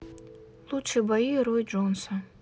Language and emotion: Russian, neutral